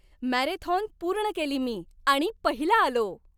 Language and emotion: Marathi, happy